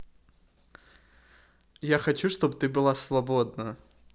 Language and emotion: Russian, positive